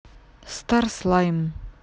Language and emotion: Russian, neutral